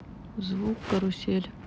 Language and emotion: Russian, neutral